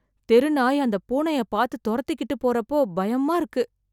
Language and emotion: Tamil, fearful